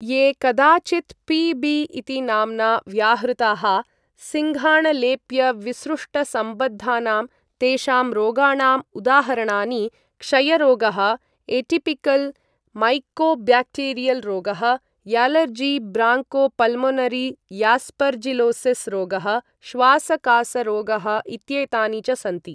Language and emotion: Sanskrit, neutral